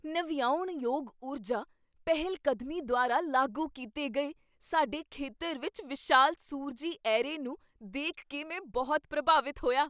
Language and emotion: Punjabi, surprised